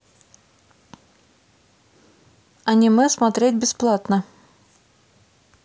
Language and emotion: Russian, neutral